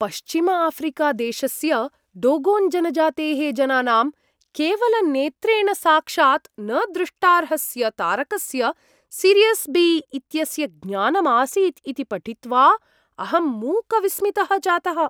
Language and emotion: Sanskrit, surprised